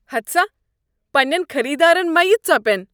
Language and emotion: Kashmiri, disgusted